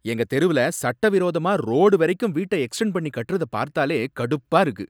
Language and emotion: Tamil, angry